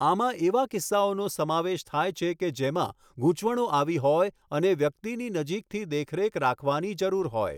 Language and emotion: Gujarati, neutral